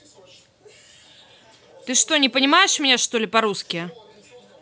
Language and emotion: Russian, angry